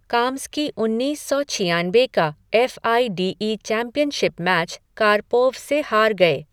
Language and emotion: Hindi, neutral